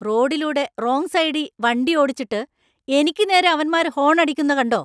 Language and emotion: Malayalam, angry